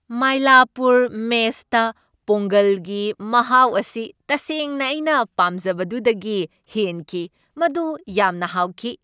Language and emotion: Manipuri, happy